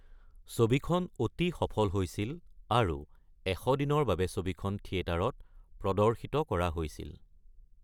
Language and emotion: Assamese, neutral